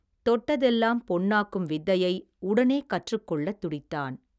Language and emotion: Tamil, neutral